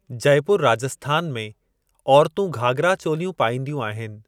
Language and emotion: Sindhi, neutral